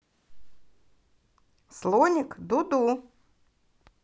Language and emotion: Russian, positive